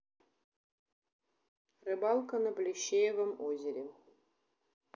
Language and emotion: Russian, neutral